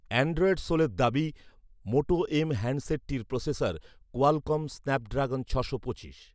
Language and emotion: Bengali, neutral